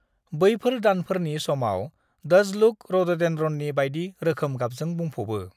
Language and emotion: Bodo, neutral